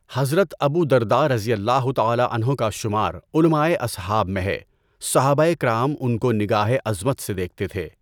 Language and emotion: Urdu, neutral